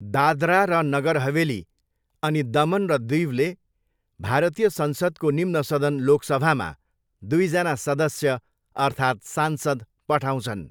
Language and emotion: Nepali, neutral